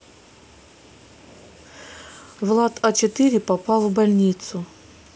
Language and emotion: Russian, sad